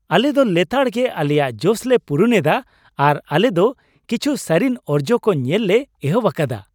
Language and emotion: Santali, happy